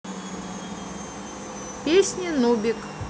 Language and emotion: Russian, neutral